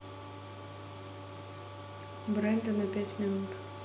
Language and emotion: Russian, neutral